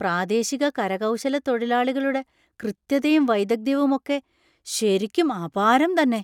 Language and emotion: Malayalam, surprised